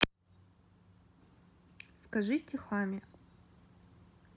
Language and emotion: Russian, neutral